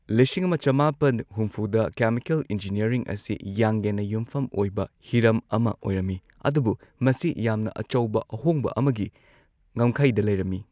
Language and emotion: Manipuri, neutral